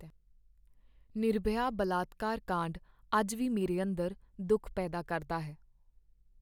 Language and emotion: Punjabi, sad